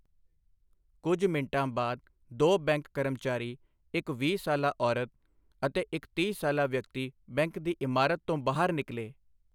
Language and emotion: Punjabi, neutral